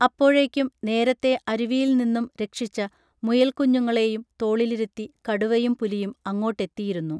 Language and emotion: Malayalam, neutral